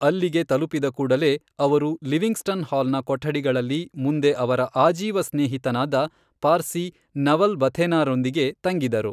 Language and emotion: Kannada, neutral